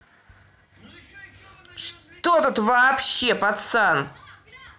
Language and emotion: Russian, angry